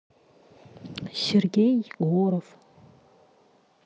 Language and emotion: Russian, neutral